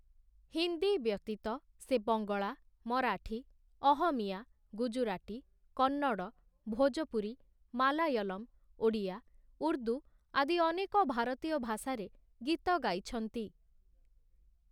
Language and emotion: Odia, neutral